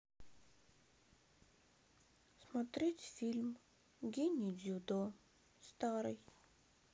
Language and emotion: Russian, sad